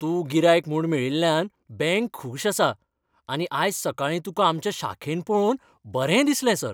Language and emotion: Goan Konkani, happy